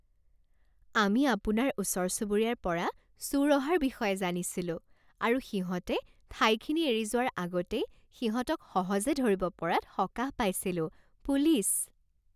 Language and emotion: Assamese, happy